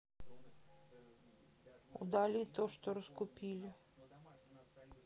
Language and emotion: Russian, sad